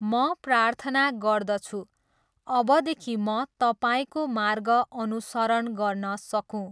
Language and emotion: Nepali, neutral